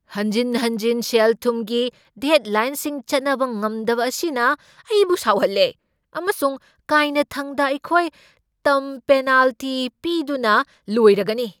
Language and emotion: Manipuri, angry